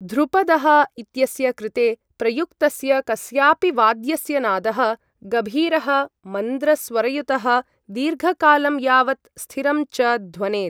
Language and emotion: Sanskrit, neutral